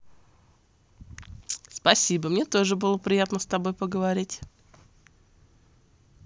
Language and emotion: Russian, positive